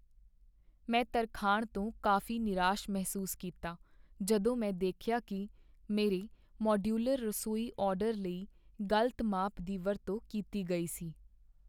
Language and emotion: Punjabi, sad